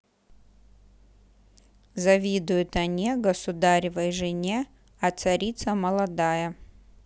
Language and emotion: Russian, neutral